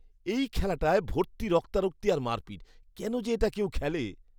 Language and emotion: Bengali, disgusted